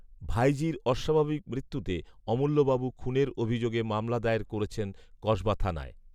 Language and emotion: Bengali, neutral